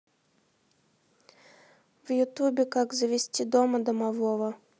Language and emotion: Russian, neutral